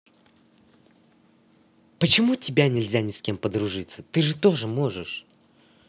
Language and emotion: Russian, angry